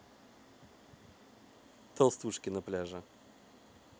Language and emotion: Russian, neutral